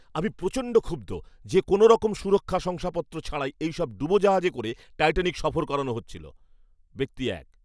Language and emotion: Bengali, angry